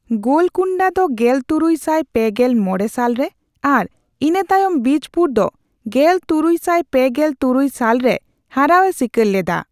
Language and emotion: Santali, neutral